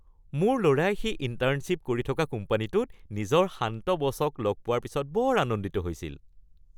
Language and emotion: Assamese, happy